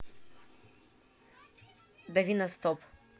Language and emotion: Russian, neutral